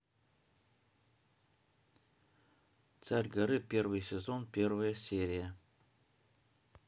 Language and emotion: Russian, neutral